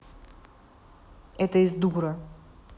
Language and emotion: Russian, angry